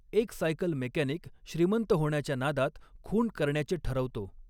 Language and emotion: Marathi, neutral